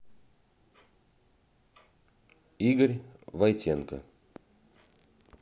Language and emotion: Russian, neutral